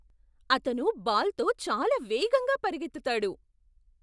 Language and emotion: Telugu, surprised